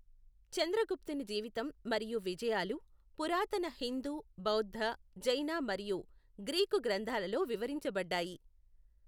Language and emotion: Telugu, neutral